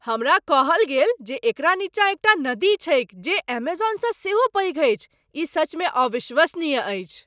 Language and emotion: Maithili, surprised